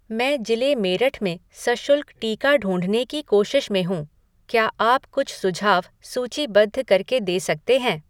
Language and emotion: Hindi, neutral